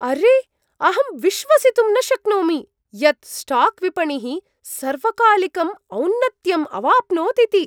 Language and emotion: Sanskrit, surprised